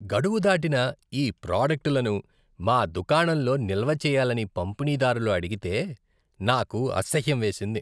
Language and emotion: Telugu, disgusted